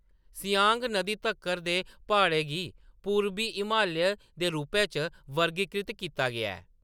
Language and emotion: Dogri, neutral